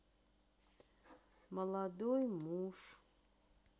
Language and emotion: Russian, sad